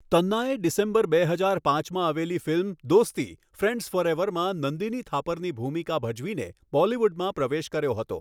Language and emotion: Gujarati, neutral